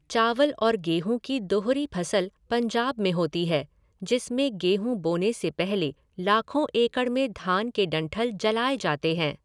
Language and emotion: Hindi, neutral